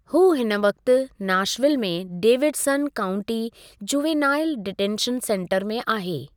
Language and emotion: Sindhi, neutral